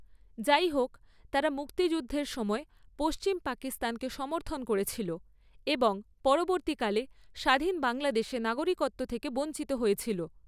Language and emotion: Bengali, neutral